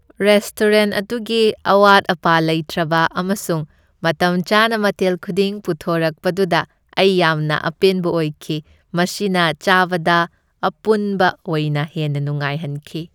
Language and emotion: Manipuri, happy